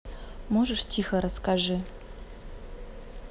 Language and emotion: Russian, neutral